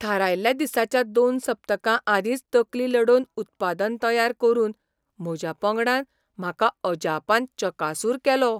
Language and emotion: Goan Konkani, surprised